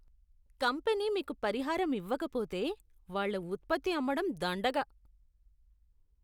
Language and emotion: Telugu, disgusted